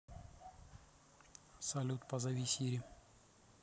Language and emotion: Russian, neutral